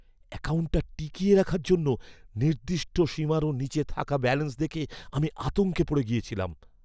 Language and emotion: Bengali, fearful